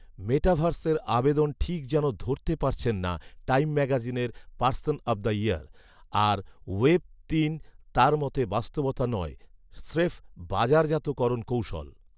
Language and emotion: Bengali, neutral